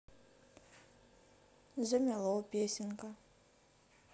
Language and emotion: Russian, neutral